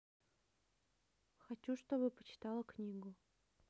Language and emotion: Russian, neutral